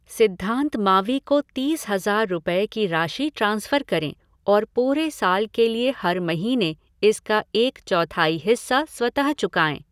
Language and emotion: Hindi, neutral